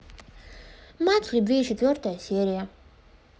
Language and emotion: Russian, neutral